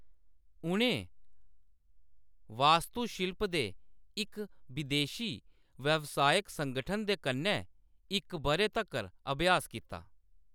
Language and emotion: Dogri, neutral